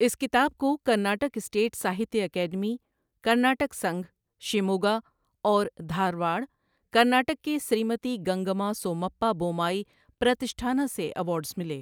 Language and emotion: Urdu, neutral